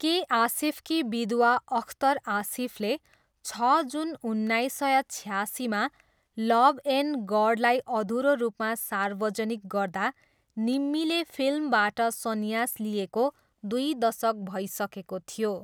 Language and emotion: Nepali, neutral